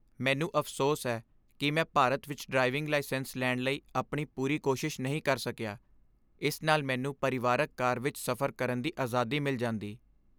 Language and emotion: Punjabi, sad